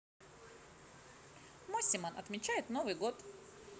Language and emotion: Russian, positive